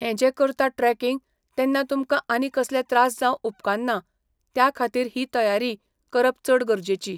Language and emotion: Goan Konkani, neutral